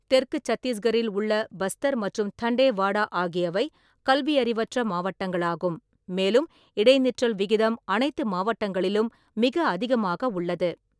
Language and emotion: Tamil, neutral